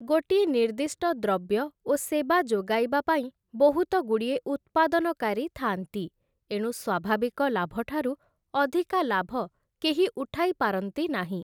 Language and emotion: Odia, neutral